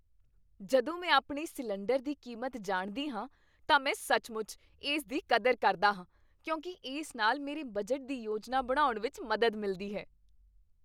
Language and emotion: Punjabi, happy